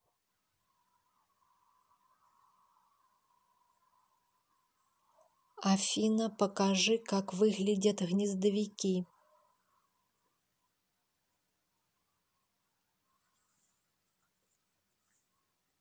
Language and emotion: Russian, neutral